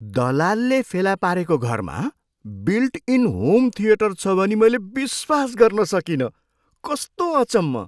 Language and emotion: Nepali, surprised